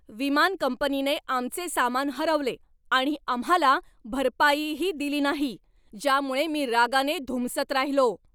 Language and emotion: Marathi, angry